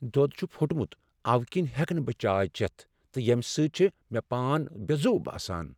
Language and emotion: Kashmiri, sad